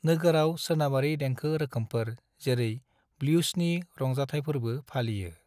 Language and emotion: Bodo, neutral